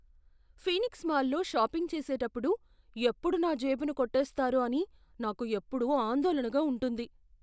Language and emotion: Telugu, fearful